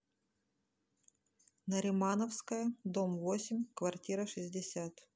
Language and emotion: Russian, neutral